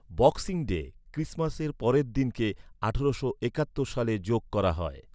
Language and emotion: Bengali, neutral